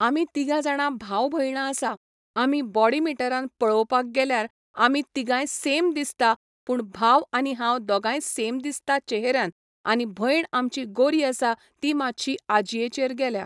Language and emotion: Goan Konkani, neutral